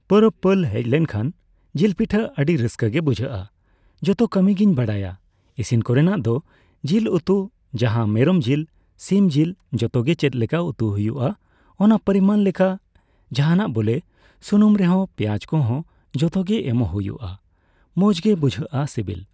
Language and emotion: Santali, neutral